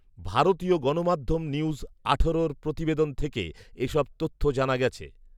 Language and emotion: Bengali, neutral